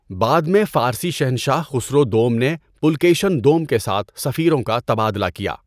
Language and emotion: Urdu, neutral